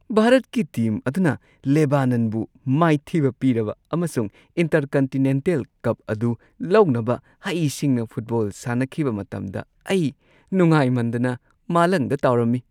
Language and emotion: Manipuri, happy